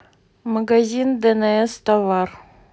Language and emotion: Russian, neutral